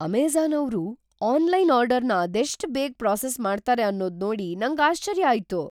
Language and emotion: Kannada, surprised